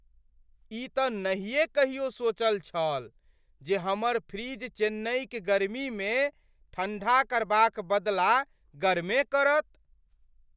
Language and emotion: Maithili, surprised